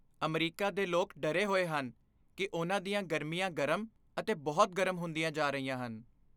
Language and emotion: Punjabi, fearful